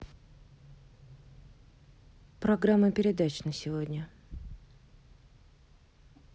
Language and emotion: Russian, neutral